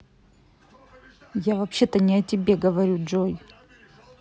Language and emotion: Russian, angry